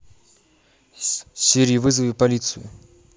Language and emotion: Russian, neutral